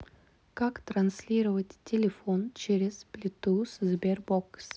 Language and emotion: Russian, neutral